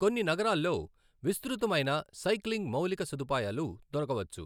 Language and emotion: Telugu, neutral